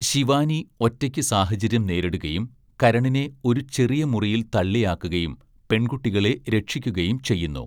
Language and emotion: Malayalam, neutral